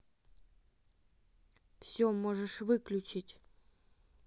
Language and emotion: Russian, neutral